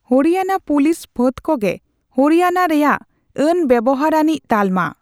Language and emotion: Santali, neutral